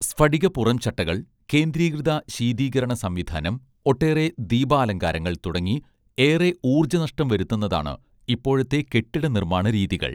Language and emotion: Malayalam, neutral